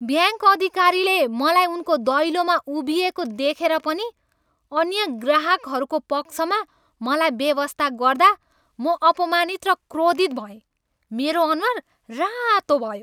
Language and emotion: Nepali, angry